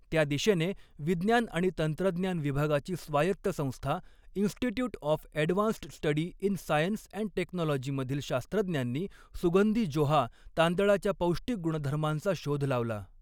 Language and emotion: Marathi, neutral